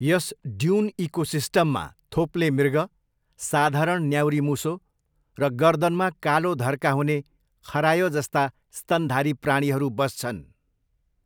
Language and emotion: Nepali, neutral